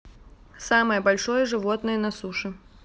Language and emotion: Russian, neutral